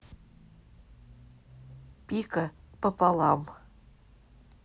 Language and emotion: Russian, neutral